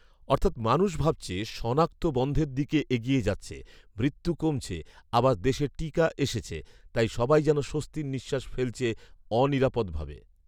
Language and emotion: Bengali, neutral